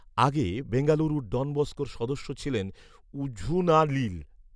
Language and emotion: Bengali, neutral